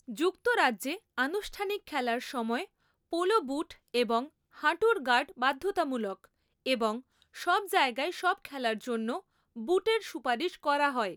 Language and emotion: Bengali, neutral